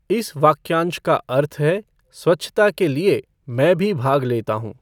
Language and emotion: Hindi, neutral